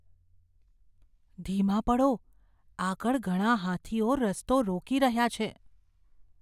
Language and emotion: Gujarati, fearful